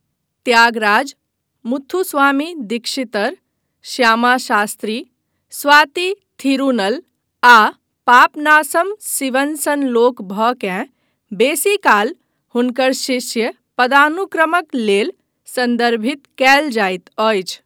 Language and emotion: Maithili, neutral